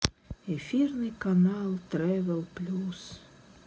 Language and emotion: Russian, sad